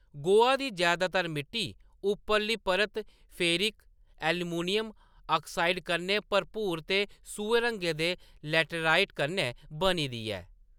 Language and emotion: Dogri, neutral